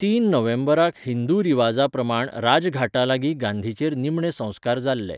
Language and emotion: Goan Konkani, neutral